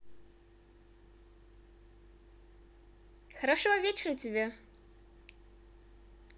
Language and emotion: Russian, positive